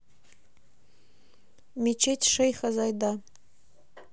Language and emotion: Russian, neutral